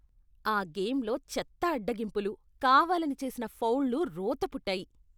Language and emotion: Telugu, disgusted